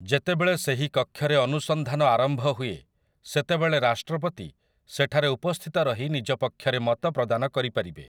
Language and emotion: Odia, neutral